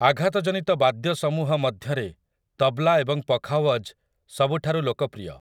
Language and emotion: Odia, neutral